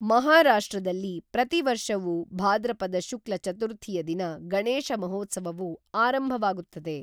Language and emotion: Kannada, neutral